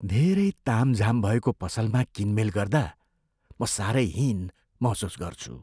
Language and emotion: Nepali, fearful